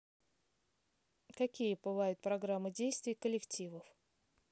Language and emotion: Russian, neutral